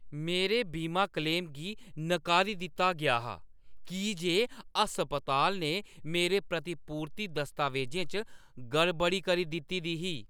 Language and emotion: Dogri, angry